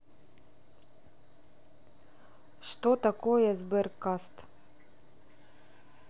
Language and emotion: Russian, neutral